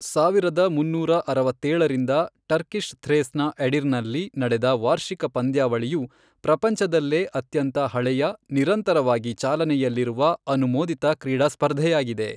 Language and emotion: Kannada, neutral